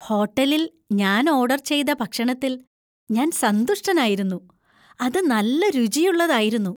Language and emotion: Malayalam, happy